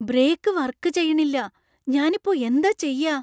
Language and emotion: Malayalam, fearful